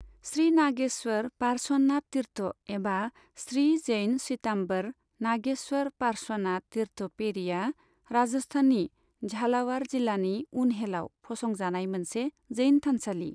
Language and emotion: Bodo, neutral